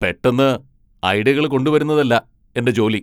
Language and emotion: Malayalam, angry